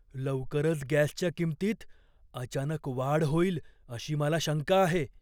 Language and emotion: Marathi, fearful